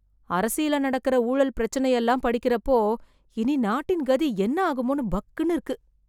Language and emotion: Tamil, fearful